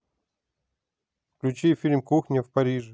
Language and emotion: Russian, neutral